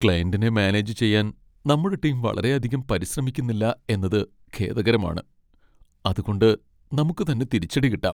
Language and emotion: Malayalam, sad